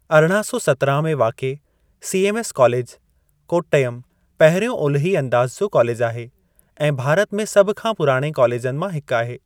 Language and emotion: Sindhi, neutral